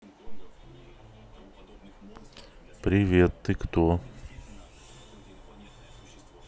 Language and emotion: Russian, neutral